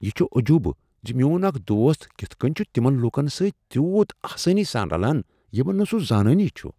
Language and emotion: Kashmiri, surprised